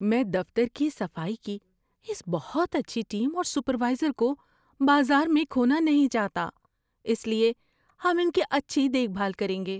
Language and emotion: Urdu, fearful